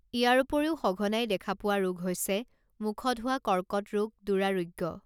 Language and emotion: Assamese, neutral